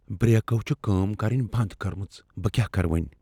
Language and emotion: Kashmiri, fearful